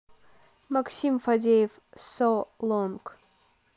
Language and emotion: Russian, neutral